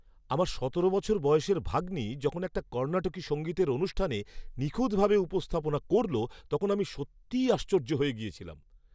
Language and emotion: Bengali, surprised